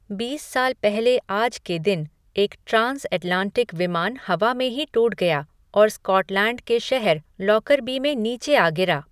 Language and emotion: Hindi, neutral